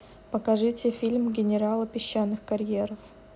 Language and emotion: Russian, neutral